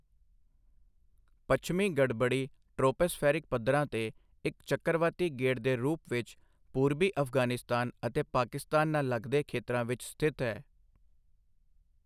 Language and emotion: Punjabi, neutral